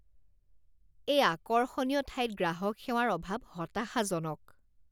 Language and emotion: Assamese, disgusted